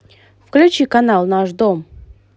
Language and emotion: Russian, positive